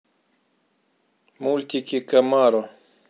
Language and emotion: Russian, neutral